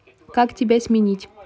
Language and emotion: Russian, neutral